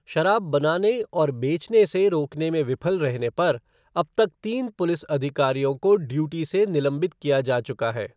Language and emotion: Hindi, neutral